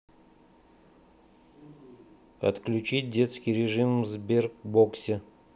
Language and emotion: Russian, neutral